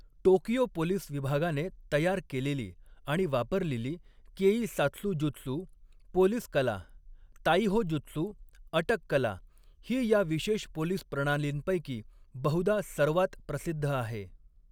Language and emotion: Marathi, neutral